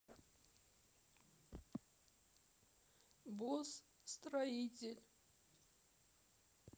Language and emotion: Russian, sad